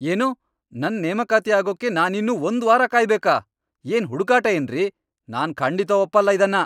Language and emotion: Kannada, angry